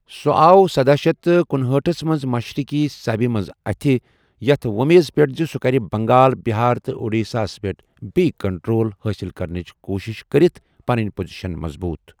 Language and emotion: Kashmiri, neutral